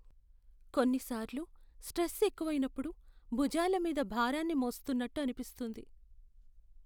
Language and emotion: Telugu, sad